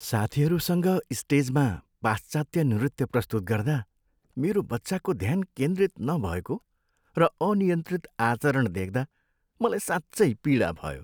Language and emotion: Nepali, sad